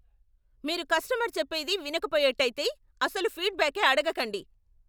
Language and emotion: Telugu, angry